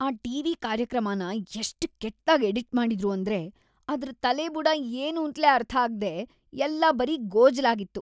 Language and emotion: Kannada, disgusted